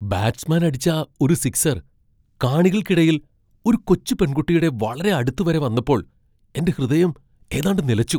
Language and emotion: Malayalam, surprised